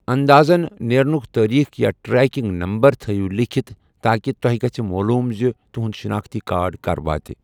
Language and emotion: Kashmiri, neutral